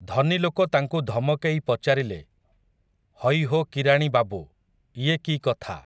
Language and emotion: Odia, neutral